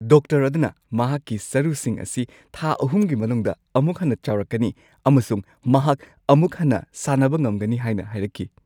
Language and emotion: Manipuri, happy